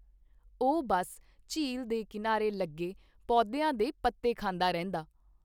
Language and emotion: Punjabi, neutral